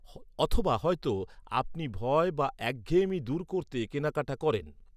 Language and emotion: Bengali, neutral